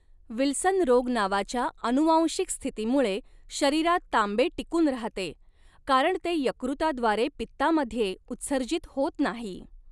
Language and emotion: Marathi, neutral